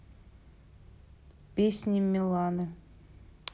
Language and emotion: Russian, neutral